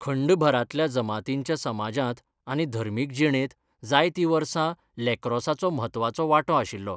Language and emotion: Goan Konkani, neutral